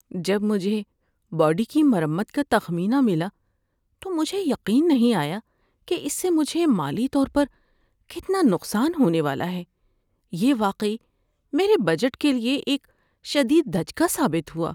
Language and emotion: Urdu, sad